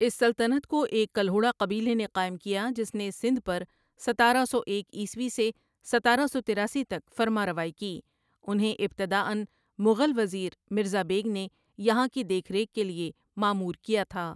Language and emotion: Urdu, neutral